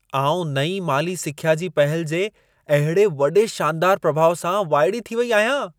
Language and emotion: Sindhi, surprised